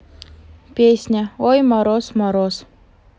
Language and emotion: Russian, neutral